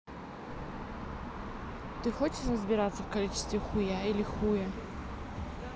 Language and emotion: Russian, neutral